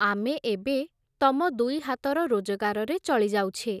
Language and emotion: Odia, neutral